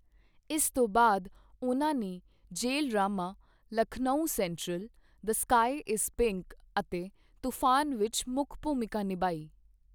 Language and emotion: Punjabi, neutral